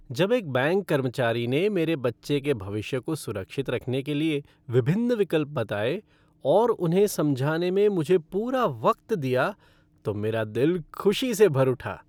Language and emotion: Hindi, happy